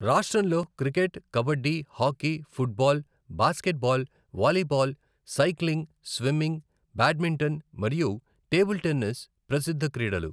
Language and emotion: Telugu, neutral